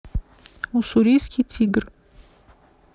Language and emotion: Russian, neutral